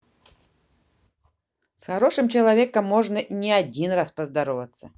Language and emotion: Russian, positive